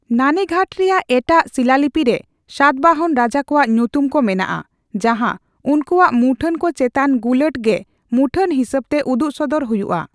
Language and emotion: Santali, neutral